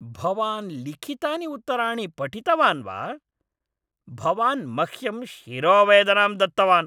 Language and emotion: Sanskrit, angry